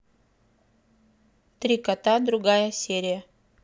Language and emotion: Russian, neutral